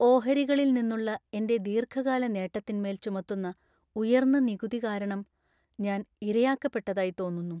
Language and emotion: Malayalam, sad